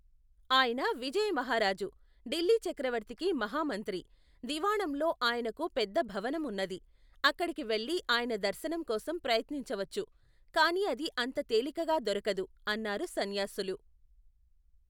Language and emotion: Telugu, neutral